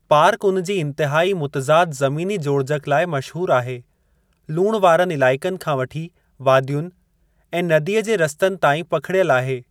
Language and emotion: Sindhi, neutral